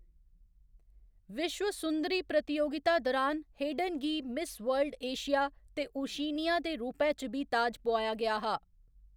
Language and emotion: Dogri, neutral